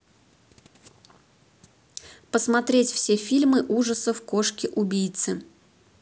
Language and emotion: Russian, neutral